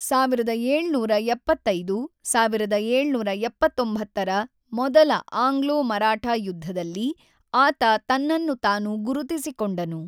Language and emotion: Kannada, neutral